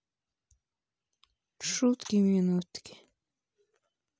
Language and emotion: Russian, sad